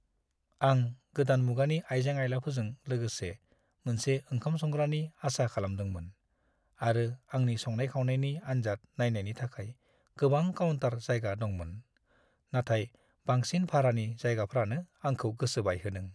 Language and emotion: Bodo, sad